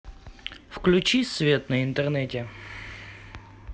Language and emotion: Russian, neutral